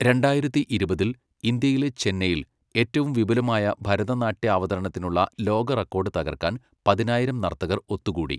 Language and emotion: Malayalam, neutral